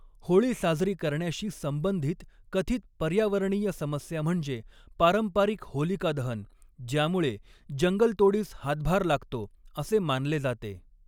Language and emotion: Marathi, neutral